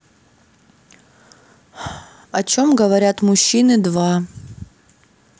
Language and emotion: Russian, neutral